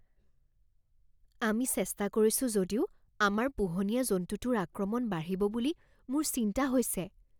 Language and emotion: Assamese, fearful